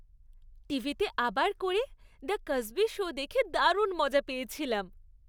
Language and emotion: Bengali, happy